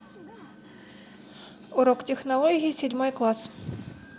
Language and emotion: Russian, neutral